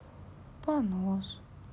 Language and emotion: Russian, sad